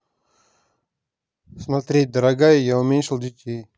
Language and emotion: Russian, neutral